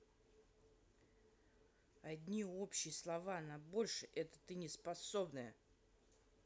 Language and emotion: Russian, angry